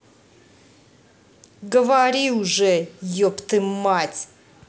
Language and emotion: Russian, angry